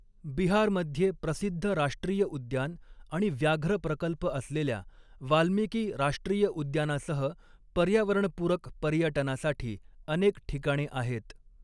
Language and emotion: Marathi, neutral